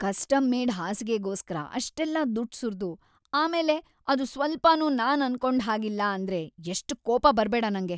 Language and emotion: Kannada, angry